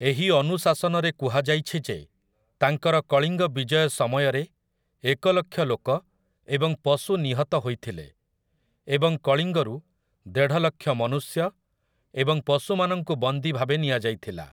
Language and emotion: Odia, neutral